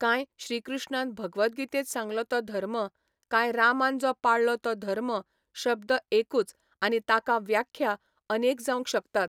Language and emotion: Goan Konkani, neutral